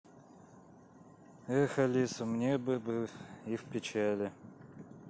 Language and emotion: Russian, sad